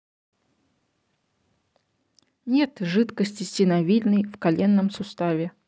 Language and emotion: Russian, neutral